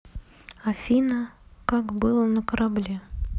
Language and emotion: Russian, neutral